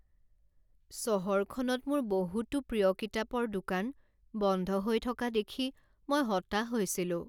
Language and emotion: Assamese, sad